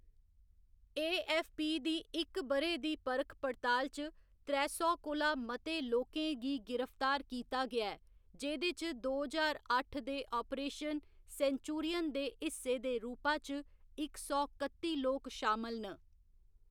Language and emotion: Dogri, neutral